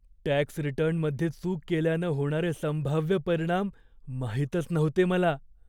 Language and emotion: Marathi, fearful